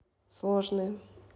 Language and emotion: Russian, neutral